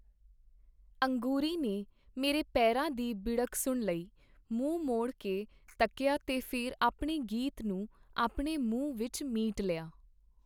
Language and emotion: Punjabi, neutral